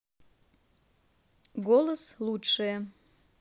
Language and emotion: Russian, neutral